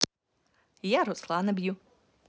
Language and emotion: Russian, positive